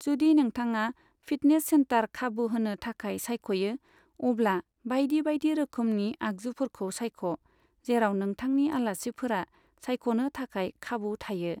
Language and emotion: Bodo, neutral